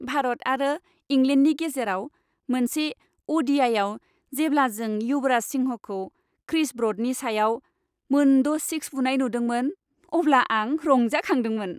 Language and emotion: Bodo, happy